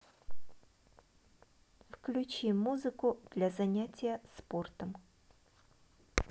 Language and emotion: Russian, neutral